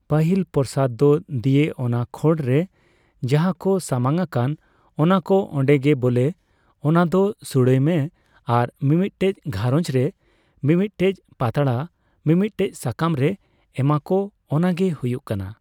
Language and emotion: Santali, neutral